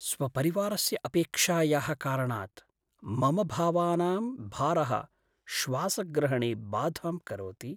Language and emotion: Sanskrit, sad